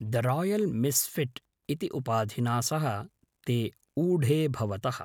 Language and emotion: Sanskrit, neutral